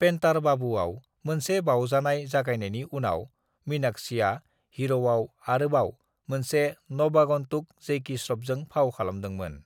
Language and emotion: Bodo, neutral